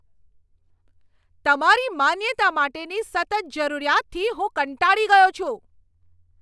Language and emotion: Gujarati, angry